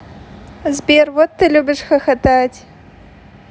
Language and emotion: Russian, positive